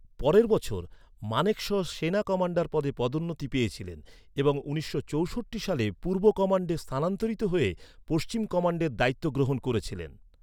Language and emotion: Bengali, neutral